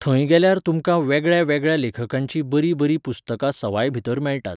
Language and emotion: Goan Konkani, neutral